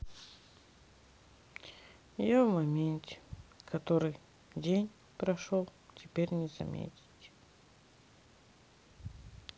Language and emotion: Russian, sad